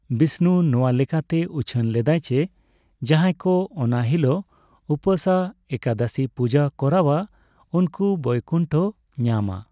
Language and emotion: Santali, neutral